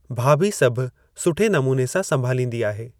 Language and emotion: Sindhi, neutral